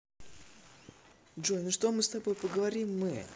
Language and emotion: Russian, positive